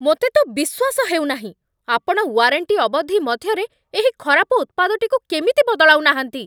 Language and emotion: Odia, angry